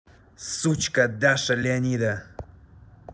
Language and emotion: Russian, angry